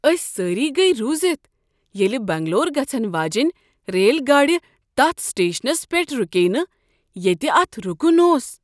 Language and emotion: Kashmiri, surprised